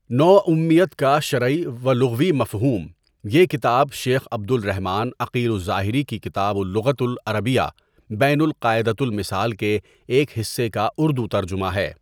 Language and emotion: Urdu, neutral